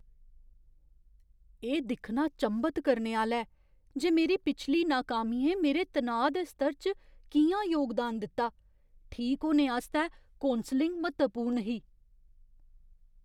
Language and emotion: Dogri, surprised